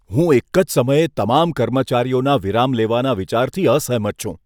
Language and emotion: Gujarati, disgusted